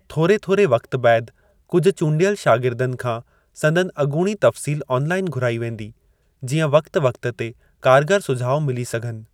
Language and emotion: Sindhi, neutral